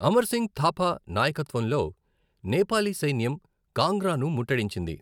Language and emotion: Telugu, neutral